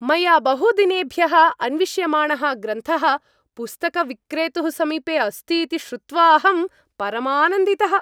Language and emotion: Sanskrit, happy